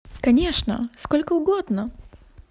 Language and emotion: Russian, positive